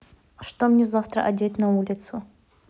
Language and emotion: Russian, neutral